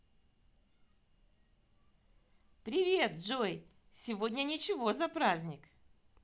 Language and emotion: Russian, positive